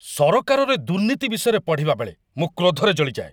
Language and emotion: Odia, angry